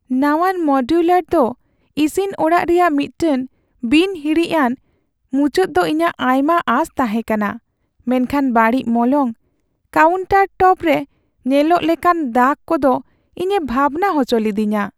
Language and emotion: Santali, sad